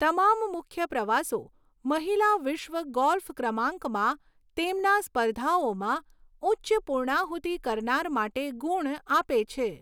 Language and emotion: Gujarati, neutral